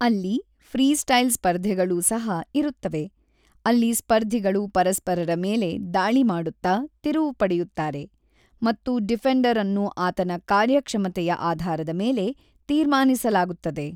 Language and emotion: Kannada, neutral